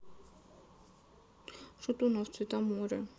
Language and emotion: Russian, sad